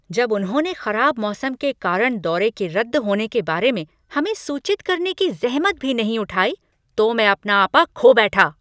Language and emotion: Hindi, angry